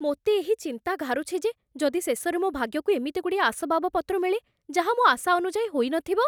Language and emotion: Odia, fearful